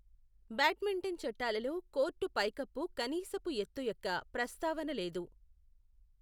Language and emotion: Telugu, neutral